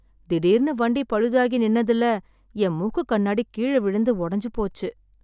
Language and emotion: Tamil, sad